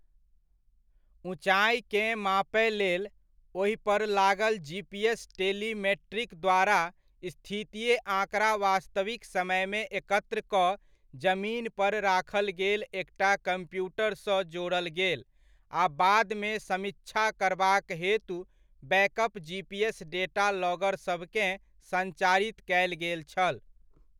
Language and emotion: Maithili, neutral